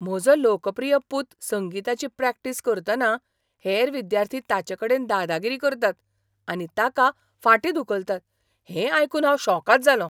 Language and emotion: Goan Konkani, surprised